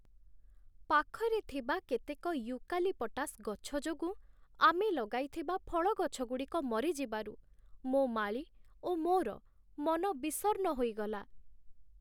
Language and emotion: Odia, sad